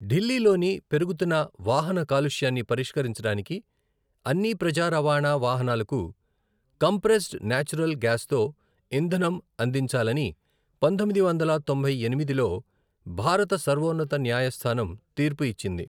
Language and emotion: Telugu, neutral